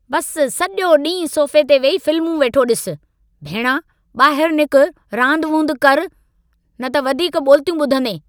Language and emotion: Sindhi, angry